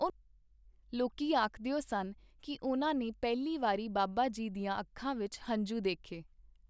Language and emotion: Punjabi, neutral